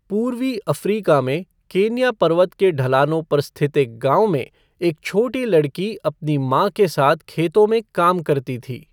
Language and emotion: Hindi, neutral